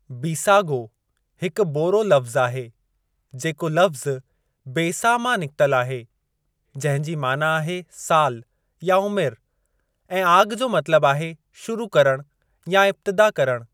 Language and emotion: Sindhi, neutral